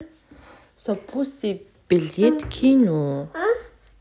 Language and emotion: Russian, neutral